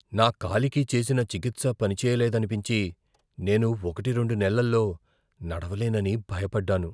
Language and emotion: Telugu, fearful